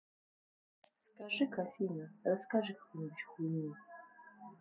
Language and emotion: Russian, neutral